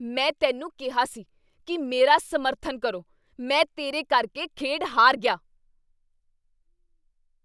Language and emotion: Punjabi, angry